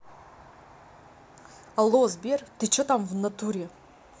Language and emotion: Russian, angry